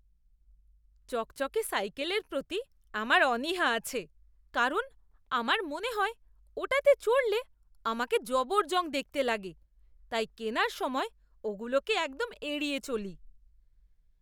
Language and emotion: Bengali, disgusted